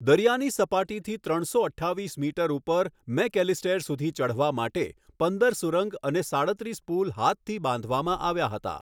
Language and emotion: Gujarati, neutral